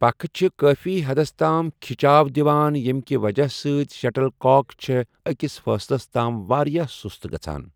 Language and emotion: Kashmiri, neutral